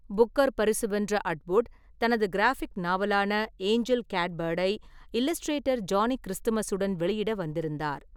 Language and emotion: Tamil, neutral